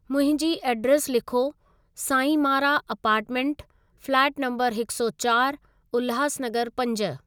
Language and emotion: Sindhi, neutral